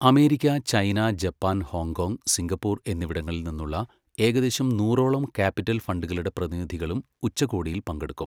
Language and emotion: Malayalam, neutral